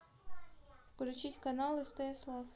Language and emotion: Russian, neutral